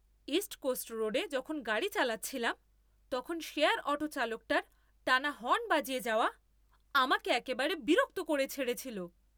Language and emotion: Bengali, angry